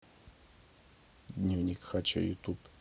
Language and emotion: Russian, neutral